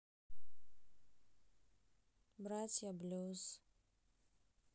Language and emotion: Russian, sad